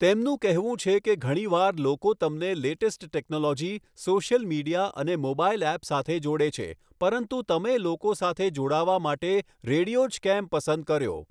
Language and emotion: Gujarati, neutral